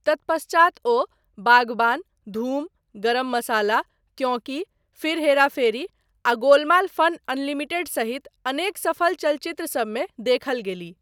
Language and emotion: Maithili, neutral